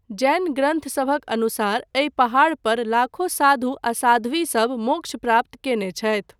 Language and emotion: Maithili, neutral